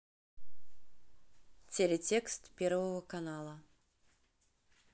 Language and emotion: Russian, neutral